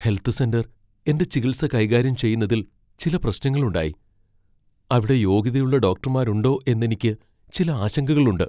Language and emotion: Malayalam, fearful